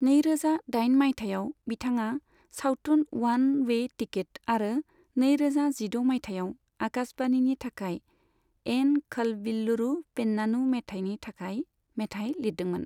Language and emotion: Bodo, neutral